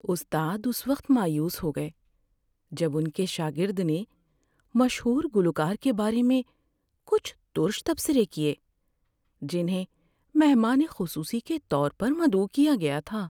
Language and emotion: Urdu, sad